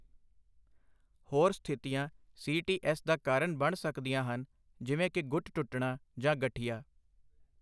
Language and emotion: Punjabi, neutral